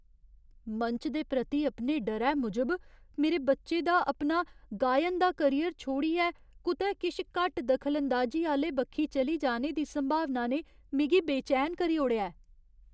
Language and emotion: Dogri, fearful